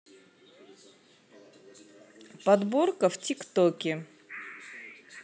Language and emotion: Russian, neutral